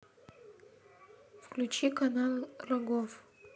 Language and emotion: Russian, neutral